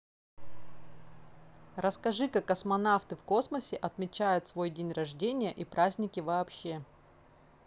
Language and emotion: Russian, neutral